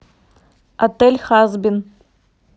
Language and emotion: Russian, neutral